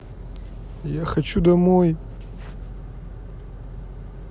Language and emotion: Russian, sad